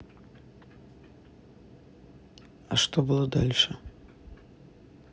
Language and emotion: Russian, neutral